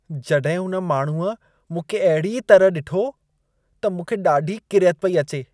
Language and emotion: Sindhi, disgusted